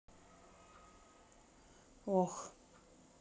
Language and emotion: Russian, sad